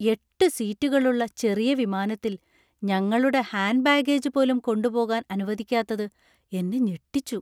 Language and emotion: Malayalam, surprised